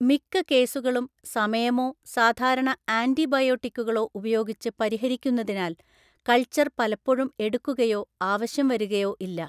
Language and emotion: Malayalam, neutral